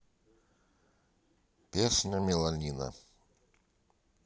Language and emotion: Russian, neutral